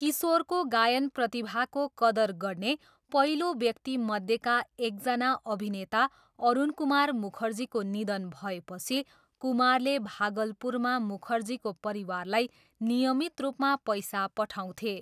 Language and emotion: Nepali, neutral